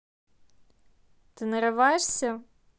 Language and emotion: Russian, angry